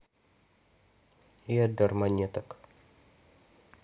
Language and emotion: Russian, neutral